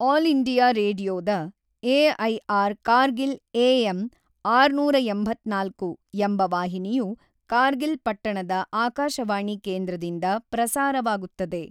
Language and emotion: Kannada, neutral